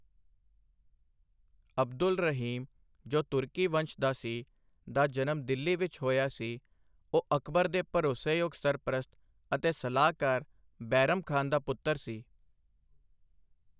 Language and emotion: Punjabi, neutral